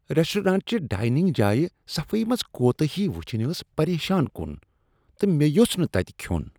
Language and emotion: Kashmiri, disgusted